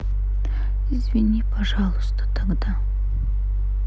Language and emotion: Russian, sad